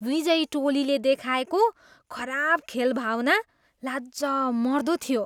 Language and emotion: Nepali, disgusted